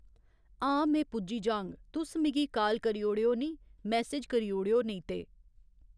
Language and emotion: Dogri, neutral